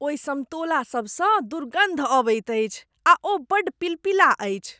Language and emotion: Maithili, disgusted